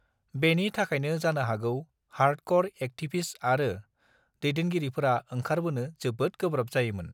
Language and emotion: Bodo, neutral